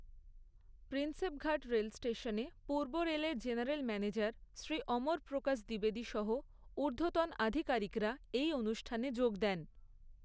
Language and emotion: Bengali, neutral